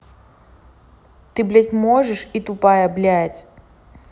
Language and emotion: Russian, angry